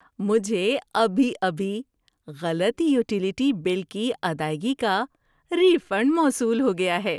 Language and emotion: Urdu, happy